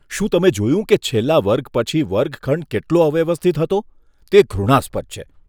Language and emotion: Gujarati, disgusted